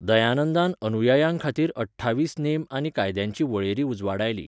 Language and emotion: Goan Konkani, neutral